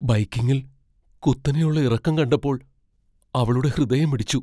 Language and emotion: Malayalam, fearful